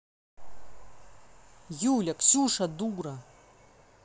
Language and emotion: Russian, angry